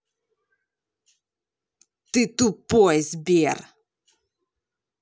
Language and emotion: Russian, angry